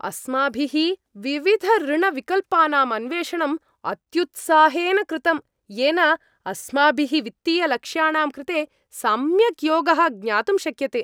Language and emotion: Sanskrit, happy